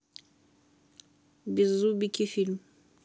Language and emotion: Russian, neutral